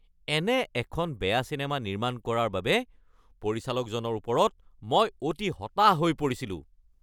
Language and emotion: Assamese, angry